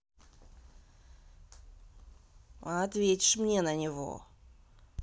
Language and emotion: Russian, angry